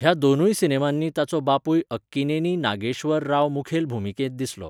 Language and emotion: Goan Konkani, neutral